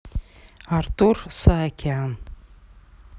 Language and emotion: Russian, neutral